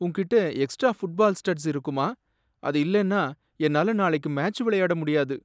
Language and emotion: Tamil, sad